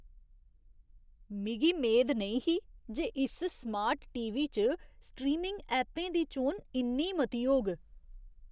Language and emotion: Dogri, surprised